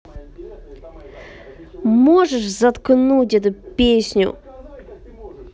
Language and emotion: Russian, angry